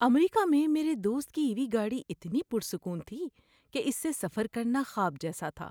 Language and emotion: Urdu, happy